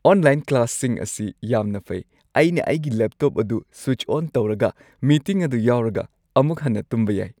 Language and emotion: Manipuri, happy